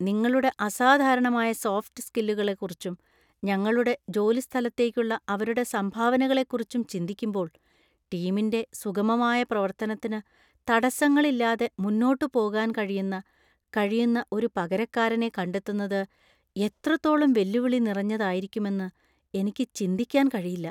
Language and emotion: Malayalam, fearful